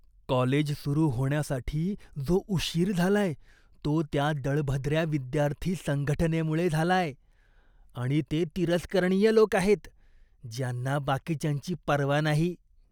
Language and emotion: Marathi, disgusted